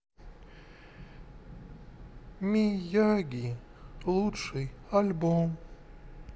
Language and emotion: Russian, sad